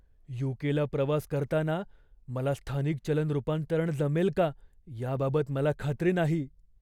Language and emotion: Marathi, fearful